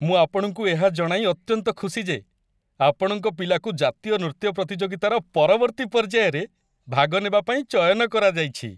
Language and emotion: Odia, happy